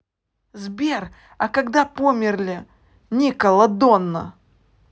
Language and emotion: Russian, neutral